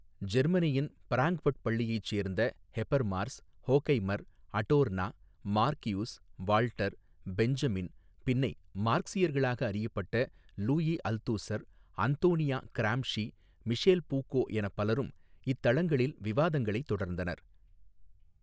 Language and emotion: Tamil, neutral